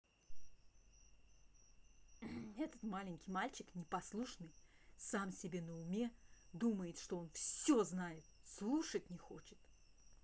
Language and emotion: Russian, angry